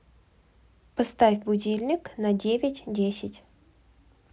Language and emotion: Russian, neutral